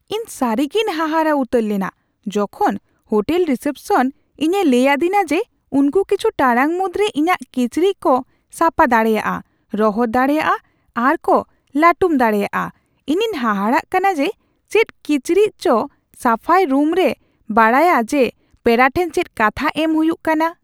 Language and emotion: Santali, surprised